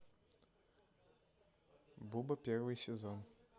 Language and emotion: Russian, neutral